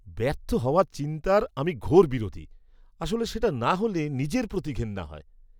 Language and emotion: Bengali, disgusted